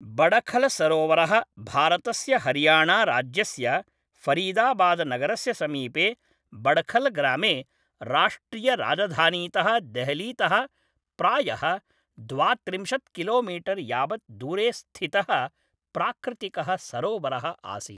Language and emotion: Sanskrit, neutral